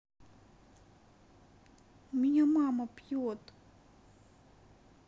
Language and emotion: Russian, sad